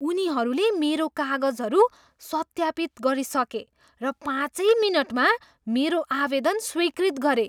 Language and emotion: Nepali, surprised